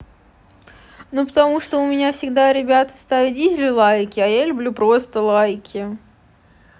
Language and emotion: Russian, neutral